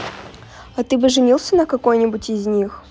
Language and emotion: Russian, neutral